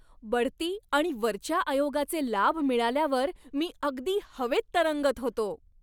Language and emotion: Marathi, happy